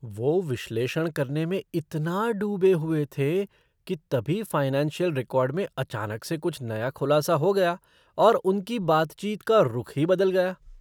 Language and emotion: Hindi, surprised